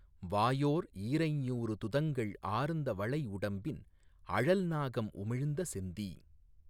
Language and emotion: Tamil, neutral